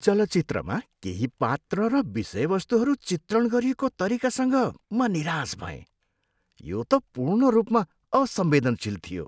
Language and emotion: Nepali, disgusted